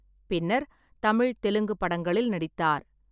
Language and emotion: Tamil, neutral